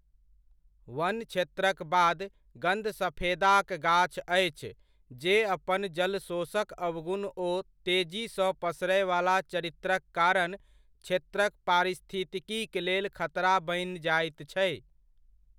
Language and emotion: Maithili, neutral